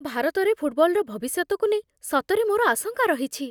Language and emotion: Odia, fearful